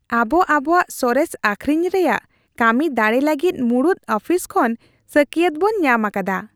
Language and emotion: Santali, happy